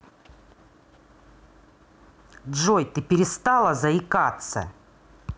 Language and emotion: Russian, angry